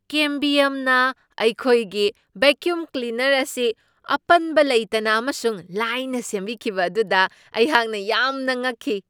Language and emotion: Manipuri, surprised